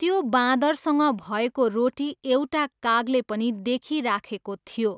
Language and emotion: Nepali, neutral